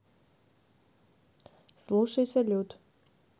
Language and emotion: Russian, neutral